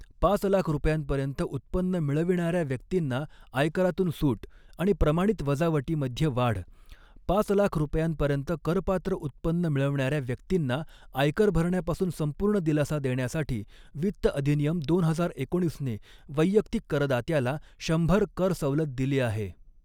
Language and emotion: Marathi, neutral